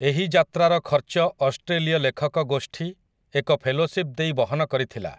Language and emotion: Odia, neutral